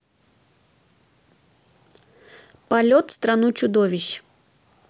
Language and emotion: Russian, neutral